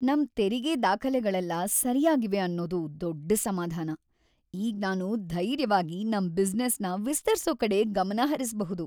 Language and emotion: Kannada, happy